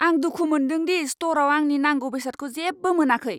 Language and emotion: Bodo, angry